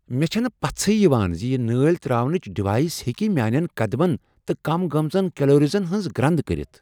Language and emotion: Kashmiri, surprised